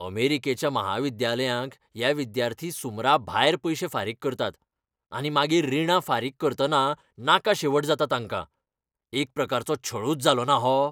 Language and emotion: Goan Konkani, angry